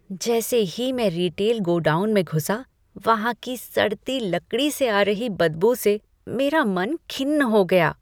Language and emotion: Hindi, disgusted